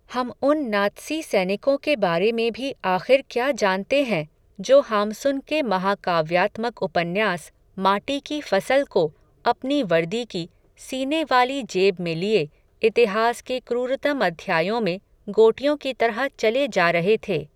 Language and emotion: Hindi, neutral